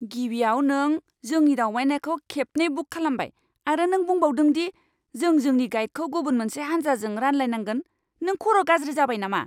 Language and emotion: Bodo, angry